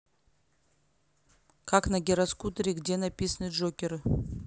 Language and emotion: Russian, neutral